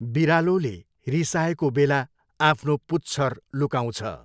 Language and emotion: Nepali, neutral